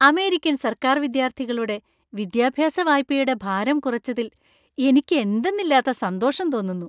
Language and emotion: Malayalam, happy